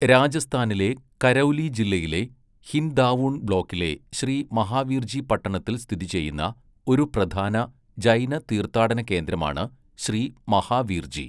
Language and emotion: Malayalam, neutral